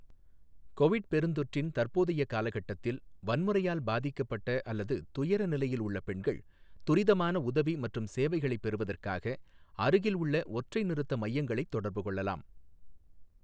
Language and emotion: Tamil, neutral